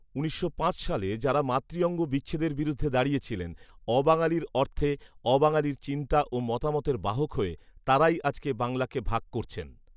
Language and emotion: Bengali, neutral